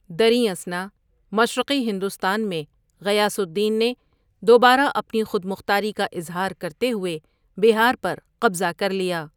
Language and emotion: Urdu, neutral